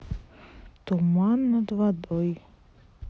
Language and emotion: Russian, neutral